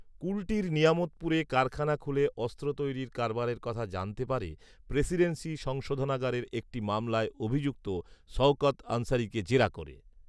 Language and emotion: Bengali, neutral